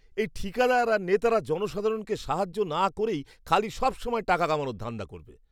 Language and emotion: Bengali, disgusted